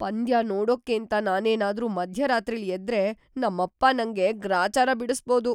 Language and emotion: Kannada, fearful